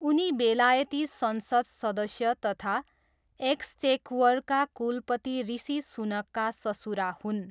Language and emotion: Nepali, neutral